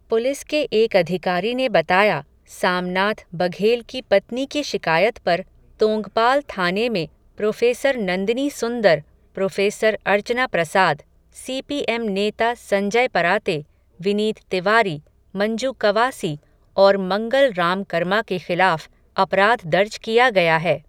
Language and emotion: Hindi, neutral